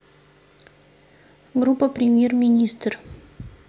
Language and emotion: Russian, neutral